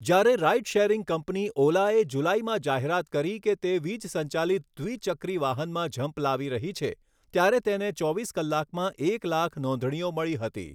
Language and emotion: Gujarati, neutral